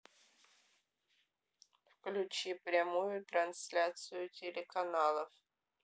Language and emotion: Russian, neutral